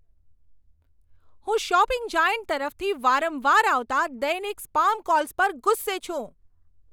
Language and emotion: Gujarati, angry